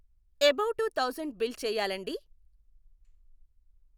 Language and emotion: Telugu, neutral